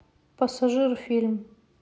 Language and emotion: Russian, neutral